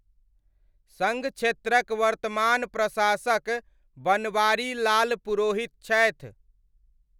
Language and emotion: Maithili, neutral